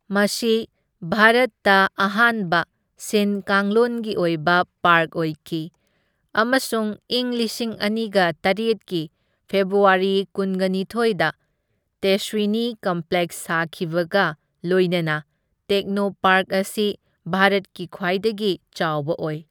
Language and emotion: Manipuri, neutral